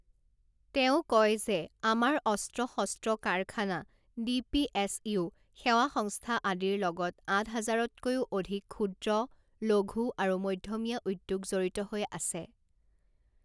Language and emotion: Assamese, neutral